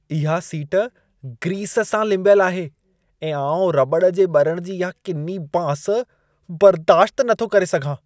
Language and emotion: Sindhi, disgusted